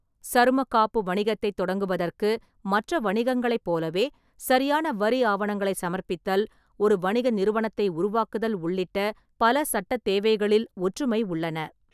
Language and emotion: Tamil, neutral